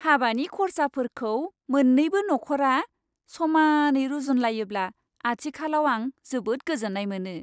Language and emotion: Bodo, happy